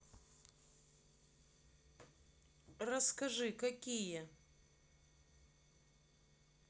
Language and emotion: Russian, neutral